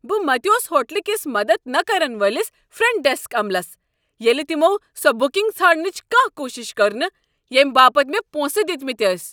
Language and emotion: Kashmiri, angry